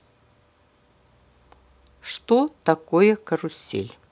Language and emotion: Russian, neutral